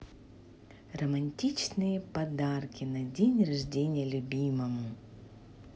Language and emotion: Russian, positive